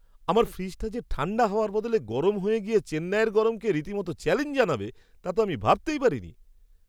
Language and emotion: Bengali, surprised